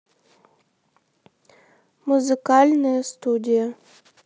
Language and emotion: Russian, neutral